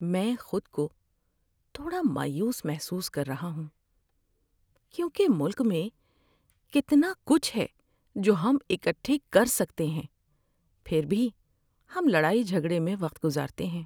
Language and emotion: Urdu, sad